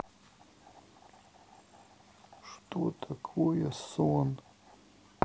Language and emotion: Russian, sad